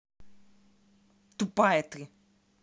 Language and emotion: Russian, angry